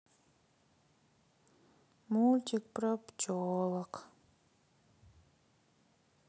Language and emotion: Russian, sad